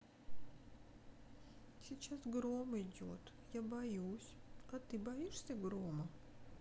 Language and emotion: Russian, sad